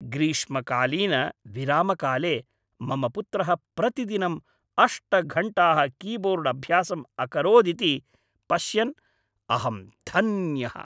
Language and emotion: Sanskrit, happy